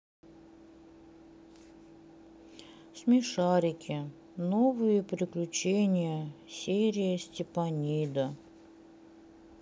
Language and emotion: Russian, sad